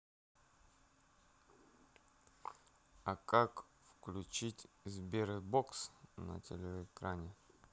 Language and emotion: Russian, neutral